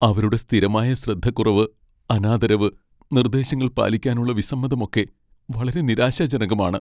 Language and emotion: Malayalam, sad